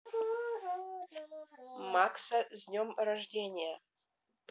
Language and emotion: Russian, neutral